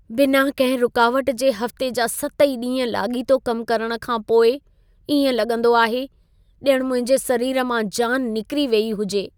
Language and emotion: Sindhi, sad